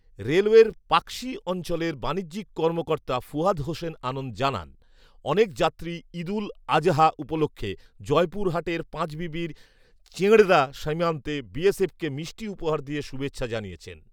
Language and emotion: Bengali, neutral